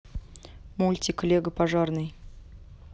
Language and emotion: Russian, neutral